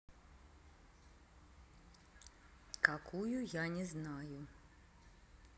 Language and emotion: Russian, neutral